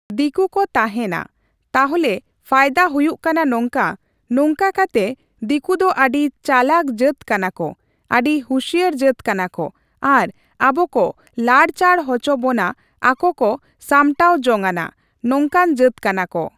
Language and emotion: Santali, neutral